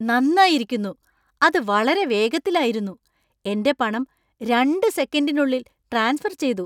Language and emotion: Malayalam, surprised